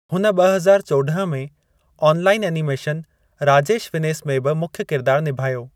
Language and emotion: Sindhi, neutral